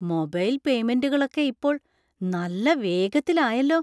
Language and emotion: Malayalam, surprised